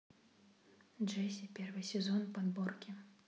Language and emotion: Russian, neutral